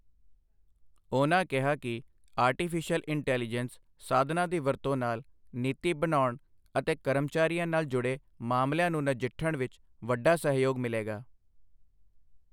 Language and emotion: Punjabi, neutral